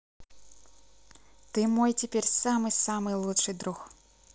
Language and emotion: Russian, positive